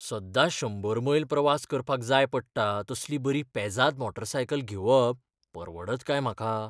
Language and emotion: Goan Konkani, fearful